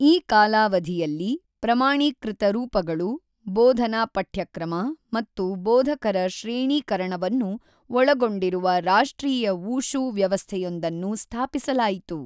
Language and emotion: Kannada, neutral